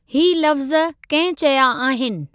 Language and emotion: Sindhi, neutral